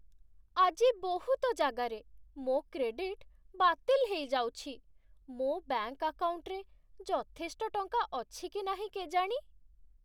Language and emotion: Odia, sad